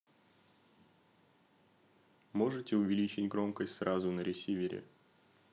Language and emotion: Russian, neutral